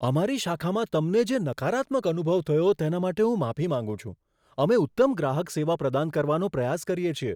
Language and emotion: Gujarati, surprised